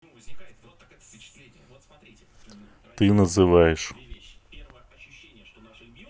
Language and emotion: Russian, neutral